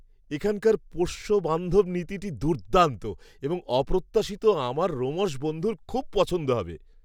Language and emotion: Bengali, surprised